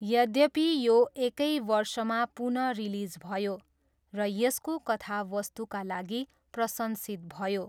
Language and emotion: Nepali, neutral